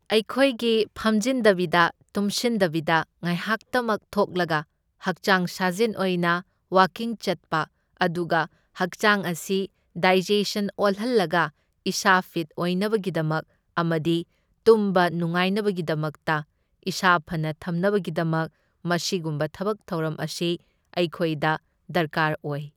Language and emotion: Manipuri, neutral